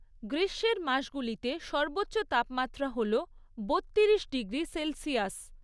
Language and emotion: Bengali, neutral